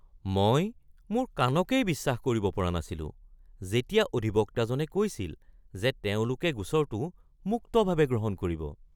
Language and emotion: Assamese, surprised